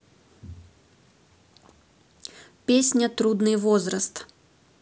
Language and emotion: Russian, neutral